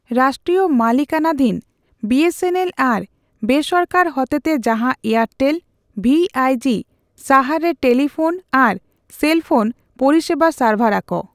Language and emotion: Santali, neutral